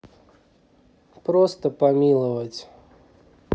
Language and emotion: Russian, neutral